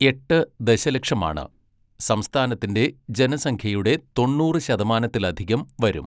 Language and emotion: Malayalam, neutral